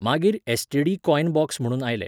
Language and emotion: Goan Konkani, neutral